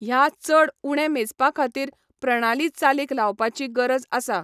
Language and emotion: Goan Konkani, neutral